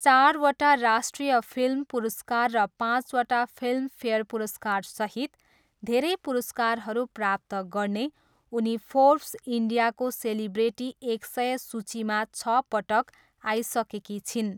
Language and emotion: Nepali, neutral